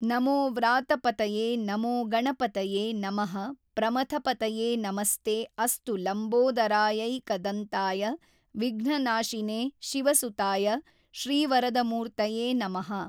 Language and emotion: Kannada, neutral